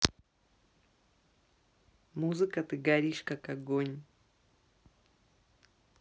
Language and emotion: Russian, neutral